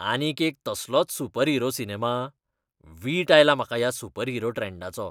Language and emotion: Goan Konkani, disgusted